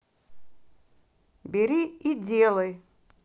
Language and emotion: Russian, angry